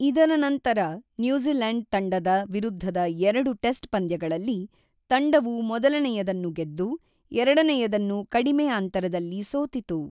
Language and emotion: Kannada, neutral